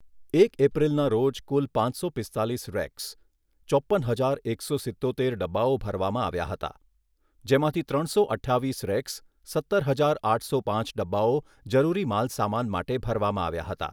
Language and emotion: Gujarati, neutral